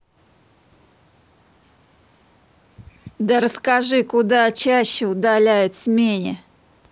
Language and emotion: Russian, angry